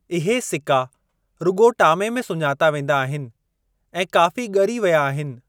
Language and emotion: Sindhi, neutral